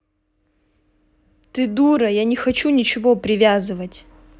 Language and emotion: Russian, angry